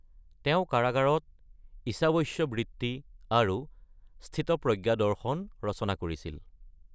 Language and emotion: Assamese, neutral